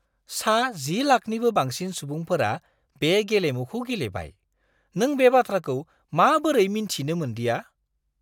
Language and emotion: Bodo, surprised